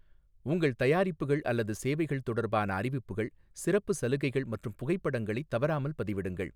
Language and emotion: Tamil, neutral